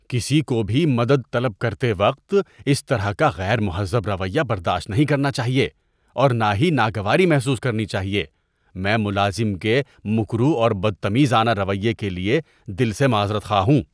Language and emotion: Urdu, disgusted